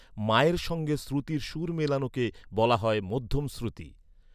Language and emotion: Bengali, neutral